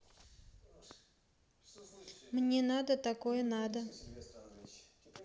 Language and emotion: Russian, neutral